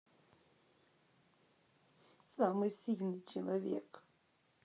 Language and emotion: Russian, sad